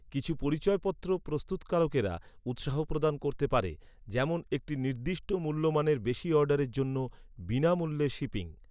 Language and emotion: Bengali, neutral